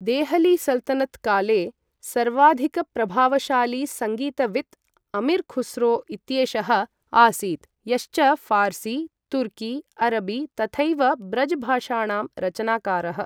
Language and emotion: Sanskrit, neutral